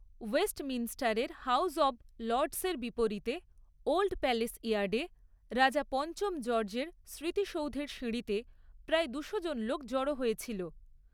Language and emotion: Bengali, neutral